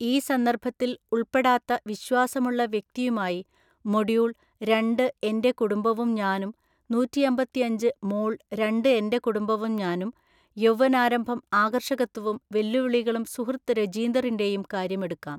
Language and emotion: Malayalam, neutral